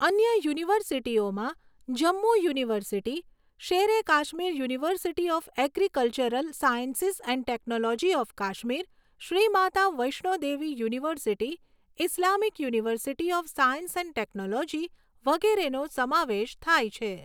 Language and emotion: Gujarati, neutral